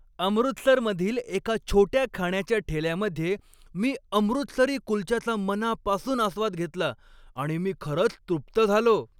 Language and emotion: Marathi, happy